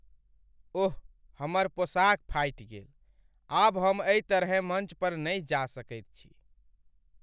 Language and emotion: Maithili, sad